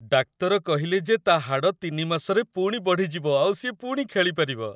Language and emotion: Odia, happy